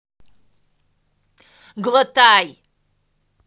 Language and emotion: Russian, angry